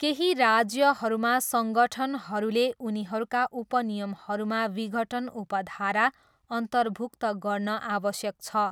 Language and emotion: Nepali, neutral